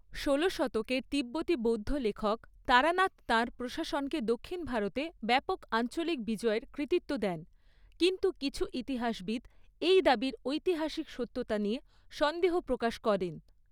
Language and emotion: Bengali, neutral